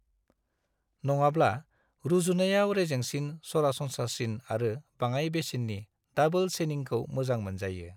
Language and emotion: Bodo, neutral